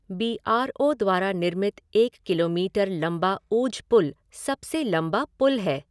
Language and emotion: Hindi, neutral